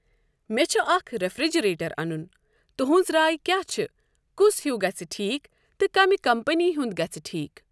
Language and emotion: Kashmiri, neutral